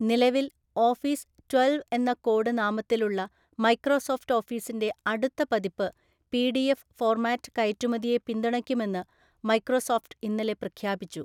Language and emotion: Malayalam, neutral